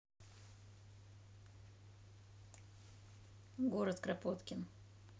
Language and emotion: Russian, neutral